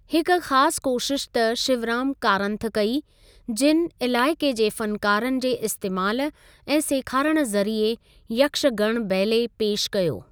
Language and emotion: Sindhi, neutral